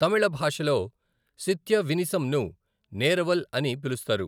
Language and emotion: Telugu, neutral